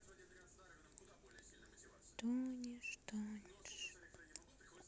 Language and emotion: Russian, sad